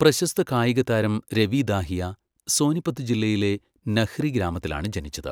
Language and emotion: Malayalam, neutral